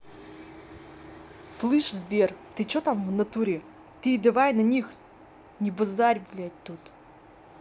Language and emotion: Russian, angry